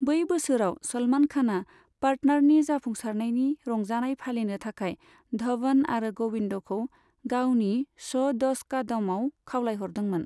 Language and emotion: Bodo, neutral